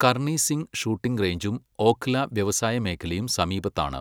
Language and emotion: Malayalam, neutral